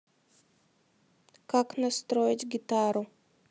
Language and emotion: Russian, neutral